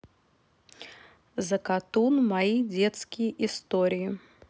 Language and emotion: Russian, neutral